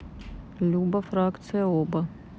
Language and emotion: Russian, neutral